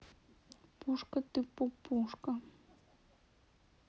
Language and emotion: Russian, neutral